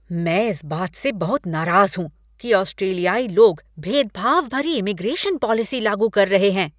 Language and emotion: Hindi, angry